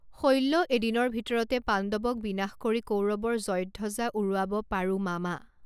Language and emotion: Assamese, neutral